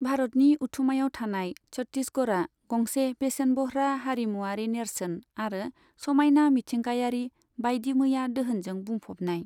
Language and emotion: Bodo, neutral